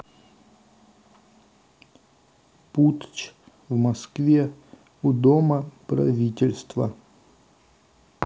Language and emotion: Russian, neutral